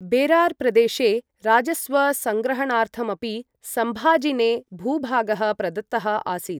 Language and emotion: Sanskrit, neutral